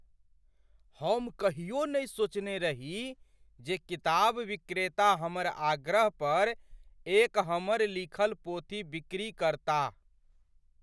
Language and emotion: Maithili, surprised